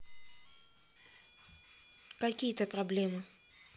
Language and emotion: Russian, neutral